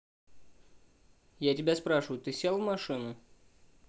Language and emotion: Russian, neutral